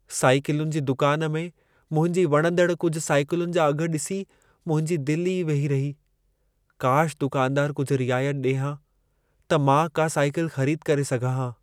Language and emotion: Sindhi, sad